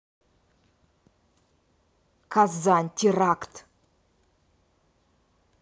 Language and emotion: Russian, angry